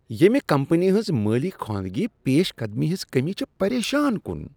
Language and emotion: Kashmiri, disgusted